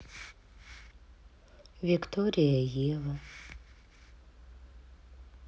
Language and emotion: Russian, sad